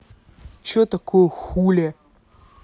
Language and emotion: Russian, angry